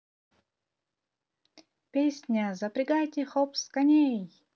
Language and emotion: Russian, positive